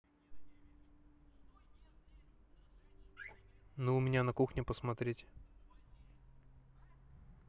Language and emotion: Russian, neutral